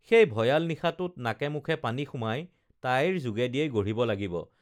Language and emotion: Assamese, neutral